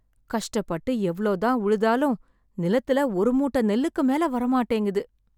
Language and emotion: Tamil, sad